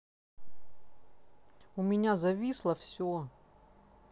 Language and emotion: Russian, neutral